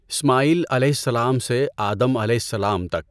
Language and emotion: Urdu, neutral